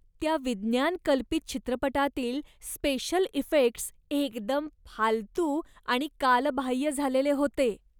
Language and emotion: Marathi, disgusted